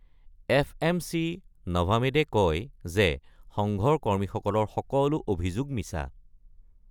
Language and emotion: Assamese, neutral